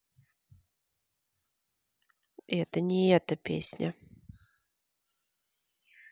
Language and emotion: Russian, neutral